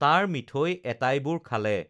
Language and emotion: Assamese, neutral